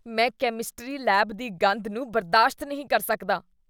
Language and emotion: Punjabi, disgusted